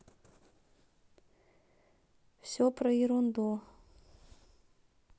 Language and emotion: Russian, neutral